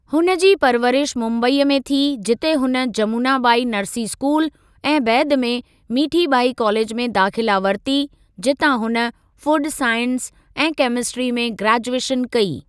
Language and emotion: Sindhi, neutral